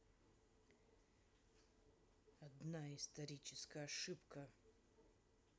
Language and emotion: Russian, neutral